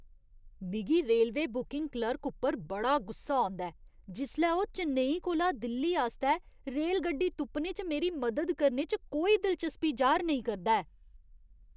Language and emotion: Dogri, disgusted